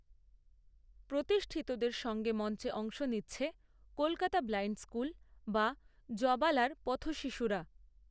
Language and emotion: Bengali, neutral